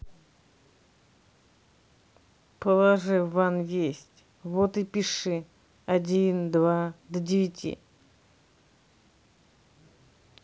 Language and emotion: Russian, neutral